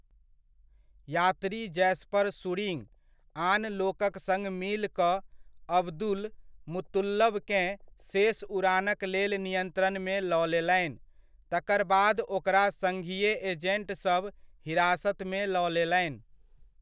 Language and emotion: Maithili, neutral